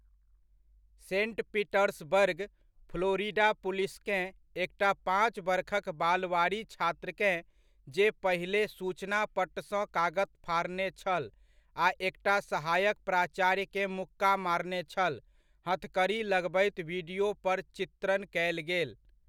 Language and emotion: Maithili, neutral